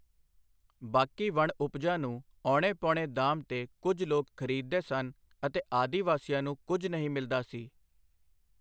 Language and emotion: Punjabi, neutral